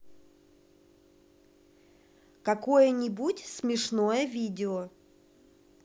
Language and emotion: Russian, positive